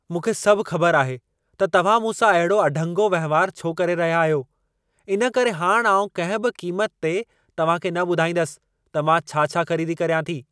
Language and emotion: Sindhi, angry